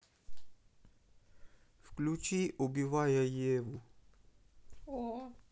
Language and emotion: Russian, neutral